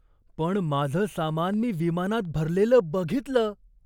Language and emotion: Marathi, surprised